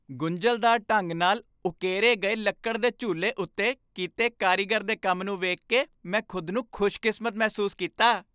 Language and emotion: Punjabi, happy